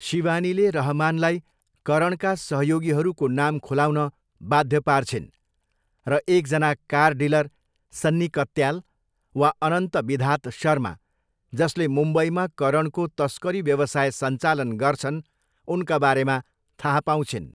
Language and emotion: Nepali, neutral